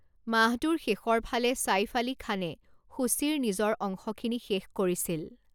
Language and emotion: Assamese, neutral